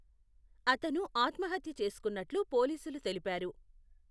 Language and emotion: Telugu, neutral